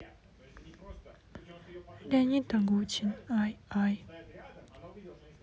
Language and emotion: Russian, sad